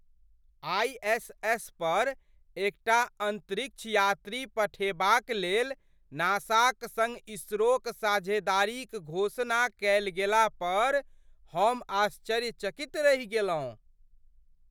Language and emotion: Maithili, surprised